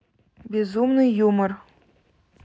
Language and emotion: Russian, neutral